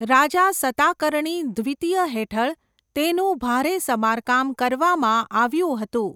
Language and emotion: Gujarati, neutral